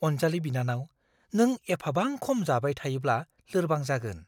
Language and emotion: Bodo, fearful